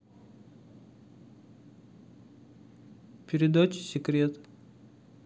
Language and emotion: Russian, neutral